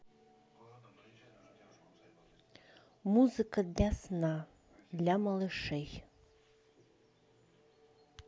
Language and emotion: Russian, neutral